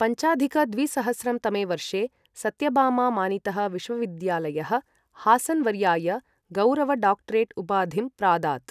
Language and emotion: Sanskrit, neutral